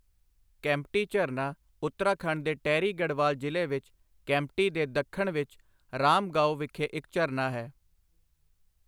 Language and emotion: Punjabi, neutral